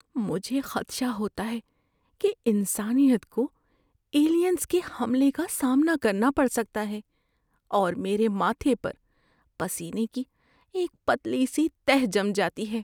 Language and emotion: Urdu, fearful